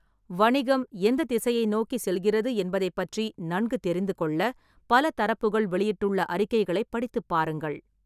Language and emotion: Tamil, neutral